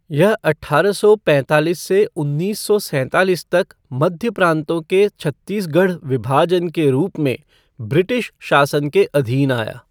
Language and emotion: Hindi, neutral